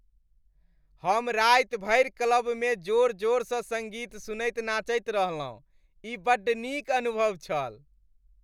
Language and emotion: Maithili, happy